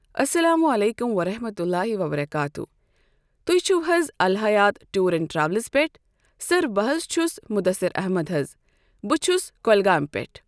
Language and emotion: Kashmiri, neutral